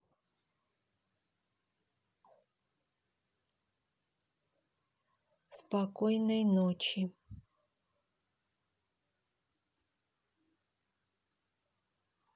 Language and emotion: Russian, neutral